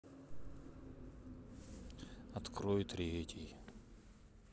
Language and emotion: Russian, sad